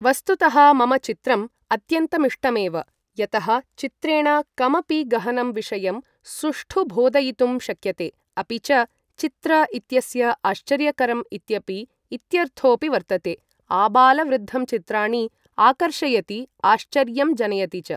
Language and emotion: Sanskrit, neutral